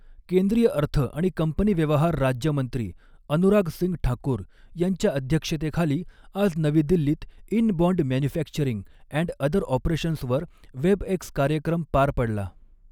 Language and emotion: Marathi, neutral